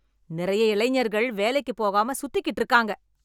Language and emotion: Tamil, angry